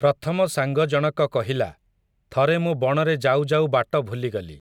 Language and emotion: Odia, neutral